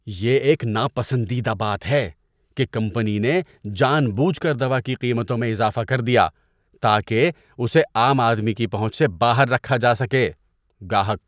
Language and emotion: Urdu, disgusted